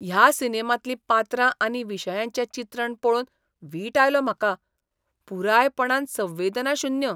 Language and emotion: Goan Konkani, disgusted